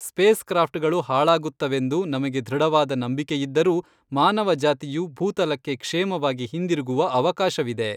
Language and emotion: Kannada, neutral